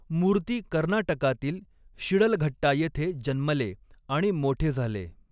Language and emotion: Marathi, neutral